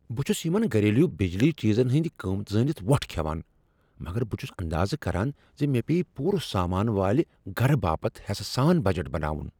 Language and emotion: Kashmiri, surprised